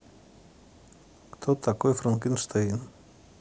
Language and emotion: Russian, neutral